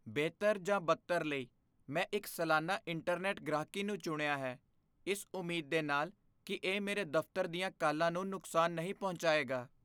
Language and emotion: Punjabi, fearful